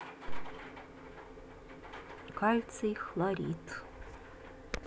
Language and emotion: Russian, neutral